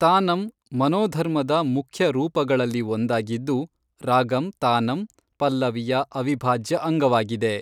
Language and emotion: Kannada, neutral